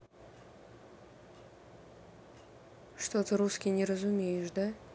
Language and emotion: Russian, sad